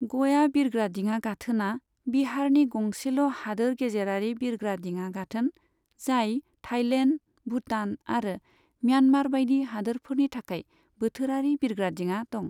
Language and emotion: Bodo, neutral